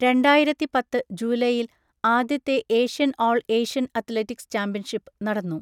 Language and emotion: Malayalam, neutral